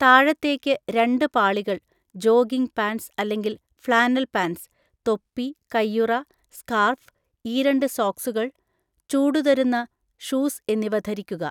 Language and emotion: Malayalam, neutral